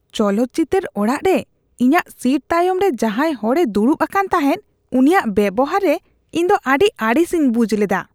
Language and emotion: Santali, disgusted